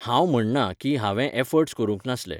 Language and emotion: Goan Konkani, neutral